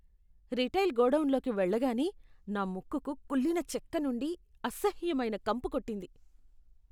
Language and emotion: Telugu, disgusted